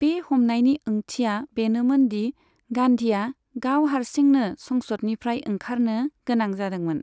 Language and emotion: Bodo, neutral